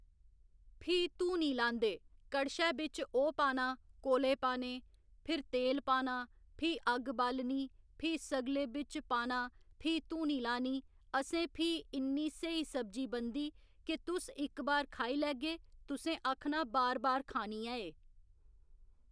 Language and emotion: Dogri, neutral